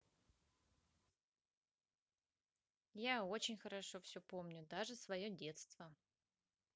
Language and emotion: Russian, positive